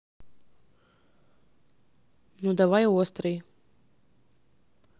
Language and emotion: Russian, neutral